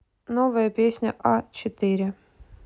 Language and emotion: Russian, neutral